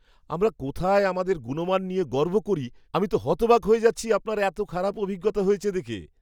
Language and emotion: Bengali, surprised